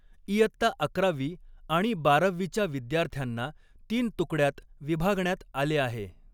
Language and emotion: Marathi, neutral